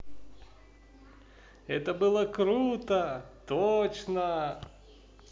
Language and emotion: Russian, positive